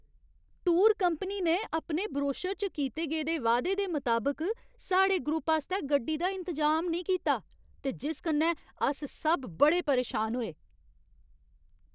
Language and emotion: Dogri, angry